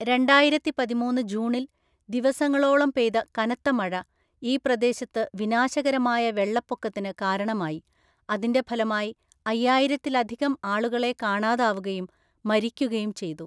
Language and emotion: Malayalam, neutral